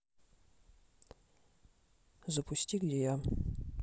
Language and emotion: Russian, neutral